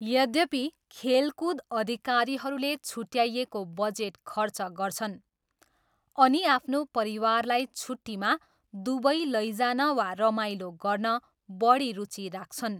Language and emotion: Nepali, neutral